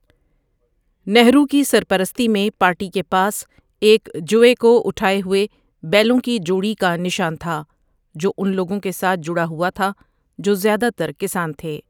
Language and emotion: Urdu, neutral